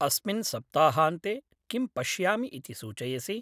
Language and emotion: Sanskrit, neutral